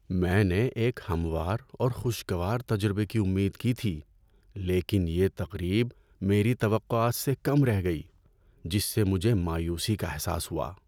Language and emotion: Urdu, sad